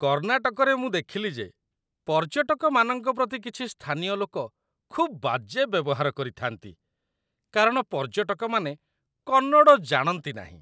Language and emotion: Odia, disgusted